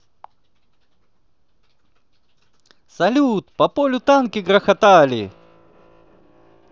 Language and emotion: Russian, positive